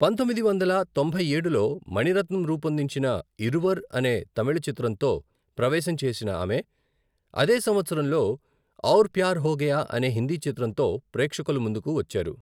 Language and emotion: Telugu, neutral